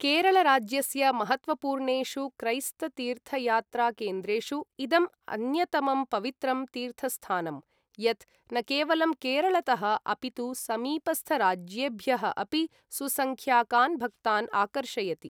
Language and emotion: Sanskrit, neutral